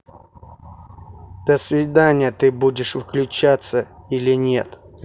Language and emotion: Russian, angry